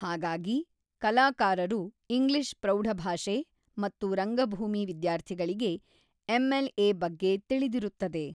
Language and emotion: Kannada, neutral